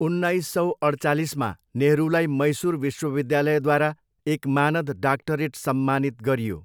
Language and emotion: Nepali, neutral